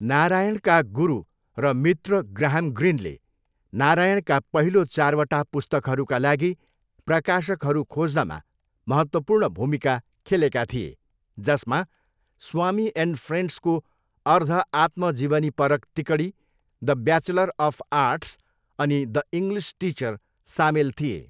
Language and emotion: Nepali, neutral